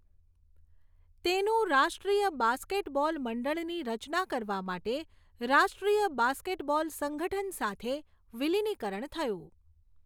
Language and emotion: Gujarati, neutral